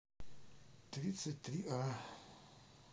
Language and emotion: Russian, sad